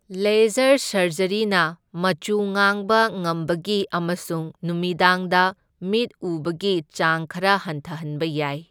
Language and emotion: Manipuri, neutral